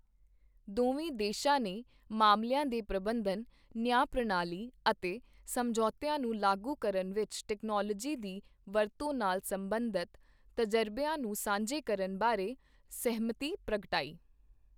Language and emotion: Punjabi, neutral